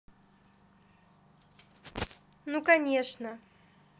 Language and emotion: Russian, positive